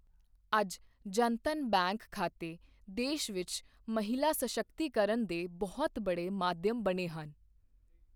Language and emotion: Punjabi, neutral